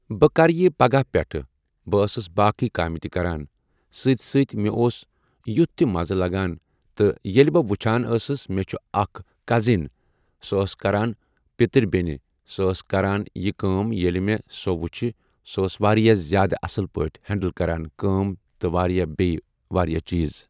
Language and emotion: Kashmiri, neutral